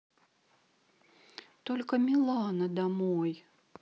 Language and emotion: Russian, sad